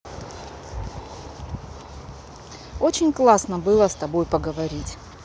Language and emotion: Russian, neutral